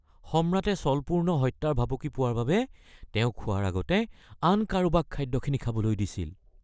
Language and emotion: Assamese, fearful